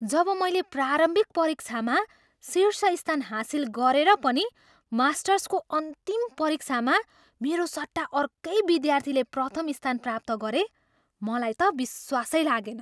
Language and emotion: Nepali, surprised